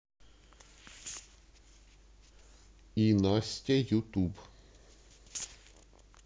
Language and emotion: Russian, neutral